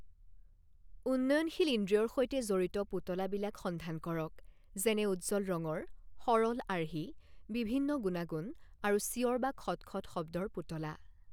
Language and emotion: Assamese, neutral